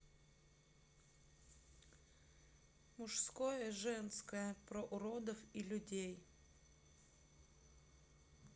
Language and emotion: Russian, neutral